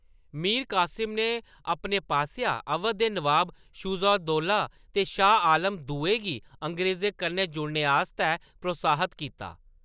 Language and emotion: Dogri, neutral